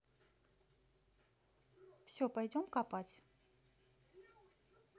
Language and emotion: Russian, neutral